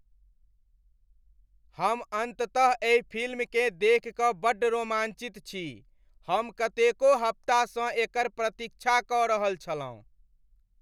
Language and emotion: Maithili, happy